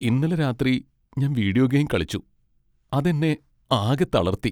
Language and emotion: Malayalam, sad